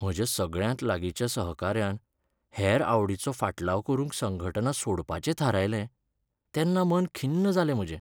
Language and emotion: Goan Konkani, sad